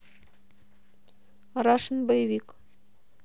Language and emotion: Russian, neutral